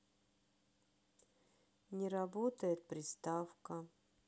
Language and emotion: Russian, sad